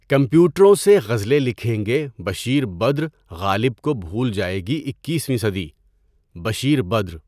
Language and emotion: Urdu, neutral